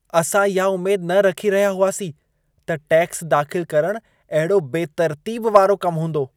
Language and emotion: Sindhi, disgusted